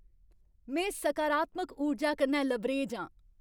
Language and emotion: Dogri, happy